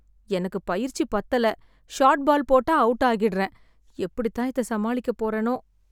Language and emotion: Tamil, sad